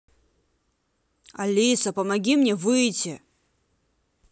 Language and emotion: Russian, angry